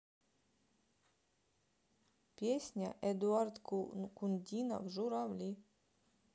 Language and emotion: Russian, neutral